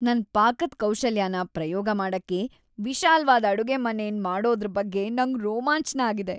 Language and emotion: Kannada, happy